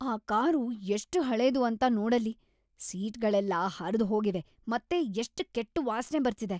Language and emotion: Kannada, disgusted